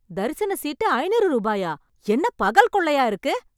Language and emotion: Tamil, angry